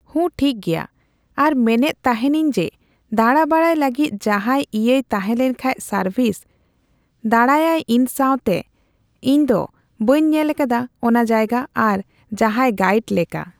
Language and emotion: Santali, neutral